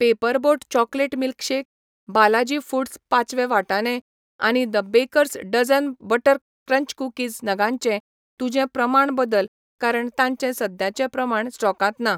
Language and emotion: Goan Konkani, neutral